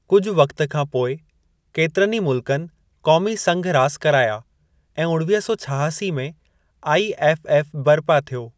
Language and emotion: Sindhi, neutral